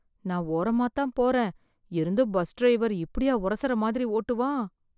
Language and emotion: Tamil, fearful